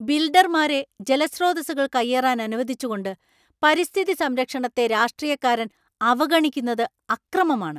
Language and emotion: Malayalam, angry